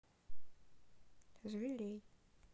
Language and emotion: Russian, neutral